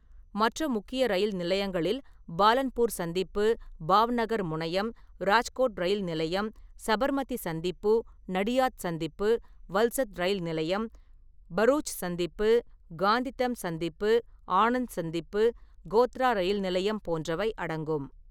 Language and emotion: Tamil, neutral